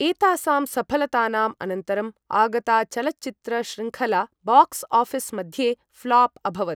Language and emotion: Sanskrit, neutral